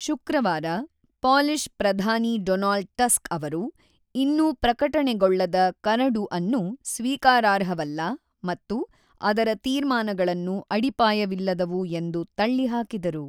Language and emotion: Kannada, neutral